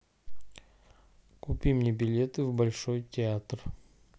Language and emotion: Russian, neutral